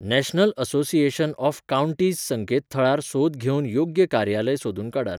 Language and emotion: Goan Konkani, neutral